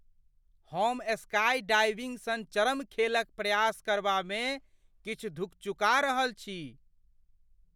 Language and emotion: Maithili, fearful